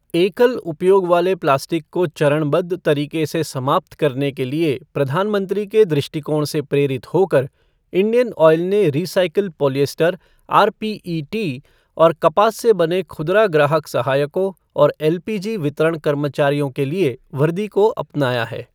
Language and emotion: Hindi, neutral